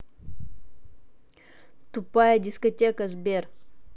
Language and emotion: Russian, angry